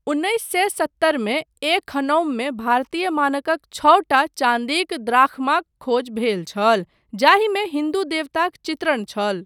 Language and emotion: Maithili, neutral